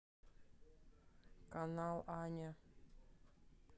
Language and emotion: Russian, neutral